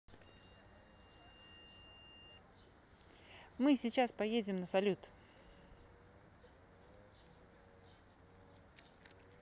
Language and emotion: Russian, positive